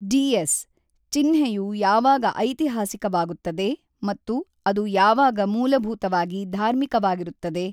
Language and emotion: Kannada, neutral